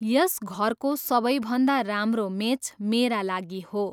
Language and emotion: Nepali, neutral